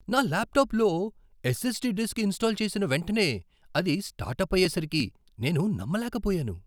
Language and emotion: Telugu, surprised